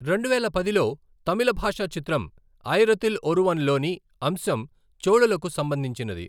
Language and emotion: Telugu, neutral